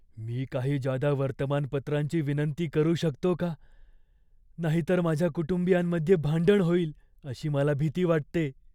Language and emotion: Marathi, fearful